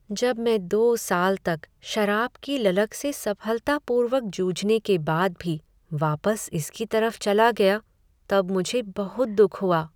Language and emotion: Hindi, sad